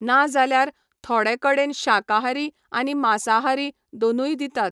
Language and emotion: Goan Konkani, neutral